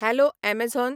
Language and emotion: Goan Konkani, neutral